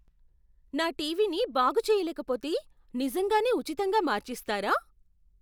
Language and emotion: Telugu, surprised